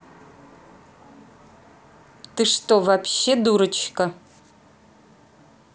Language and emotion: Russian, angry